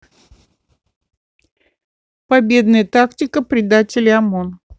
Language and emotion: Russian, neutral